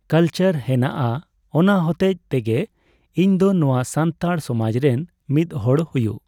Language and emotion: Santali, neutral